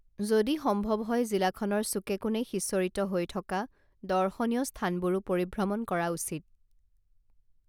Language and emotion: Assamese, neutral